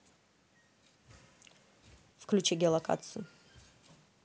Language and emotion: Russian, neutral